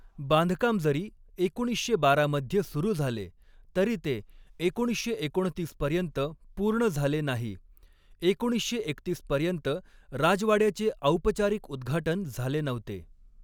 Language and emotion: Marathi, neutral